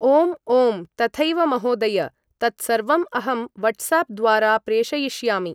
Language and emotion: Sanskrit, neutral